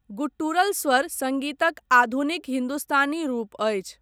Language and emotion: Maithili, neutral